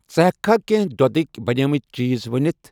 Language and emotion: Kashmiri, neutral